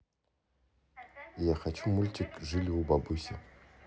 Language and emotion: Russian, neutral